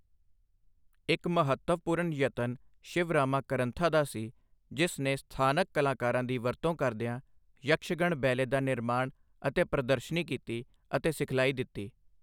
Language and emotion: Punjabi, neutral